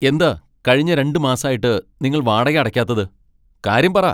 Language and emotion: Malayalam, angry